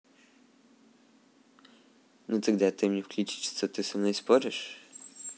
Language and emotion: Russian, neutral